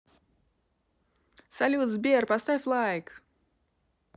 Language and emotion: Russian, positive